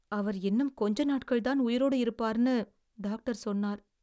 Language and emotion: Tamil, sad